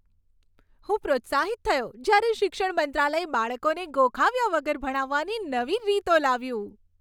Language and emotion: Gujarati, happy